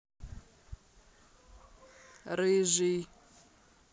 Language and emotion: Russian, neutral